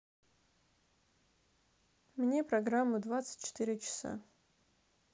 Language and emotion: Russian, neutral